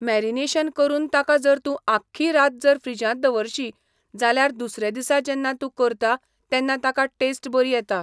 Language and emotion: Goan Konkani, neutral